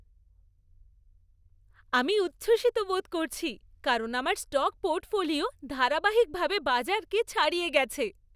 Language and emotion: Bengali, happy